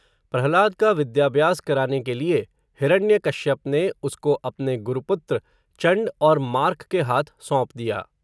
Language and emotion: Hindi, neutral